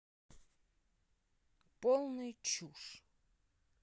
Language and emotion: Russian, neutral